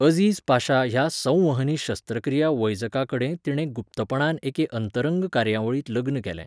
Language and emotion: Goan Konkani, neutral